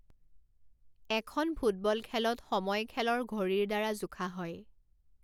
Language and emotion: Assamese, neutral